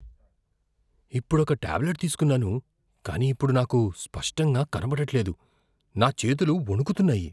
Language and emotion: Telugu, fearful